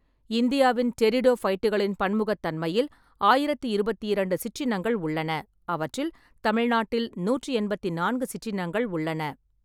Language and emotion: Tamil, neutral